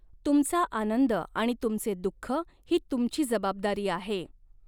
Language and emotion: Marathi, neutral